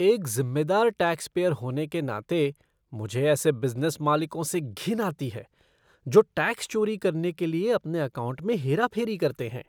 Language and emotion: Hindi, disgusted